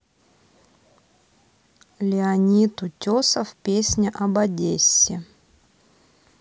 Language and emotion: Russian, neutral